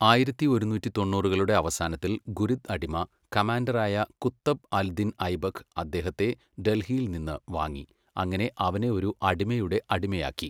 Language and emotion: Malayalam, neutral